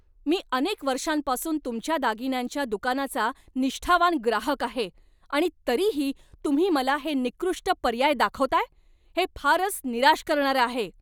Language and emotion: Marathi, angry